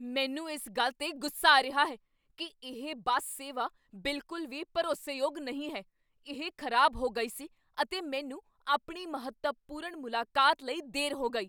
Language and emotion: Punjabi, angry